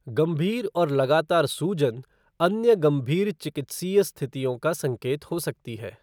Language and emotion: Hindi, neutral